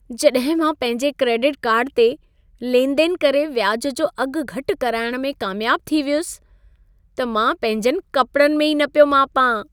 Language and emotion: Sindhi, happy